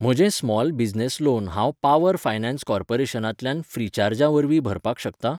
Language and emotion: Goan Konkani, neutral